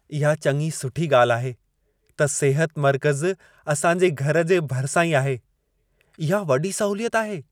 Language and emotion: Sindhi, happy